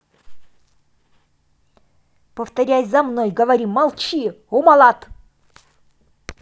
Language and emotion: Russian, angry